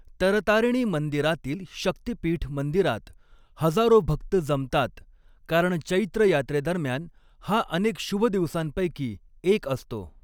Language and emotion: Marathi, neutral